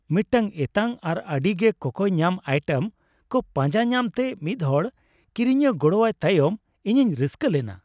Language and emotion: Santali, happy